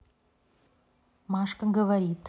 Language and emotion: Russian, neutral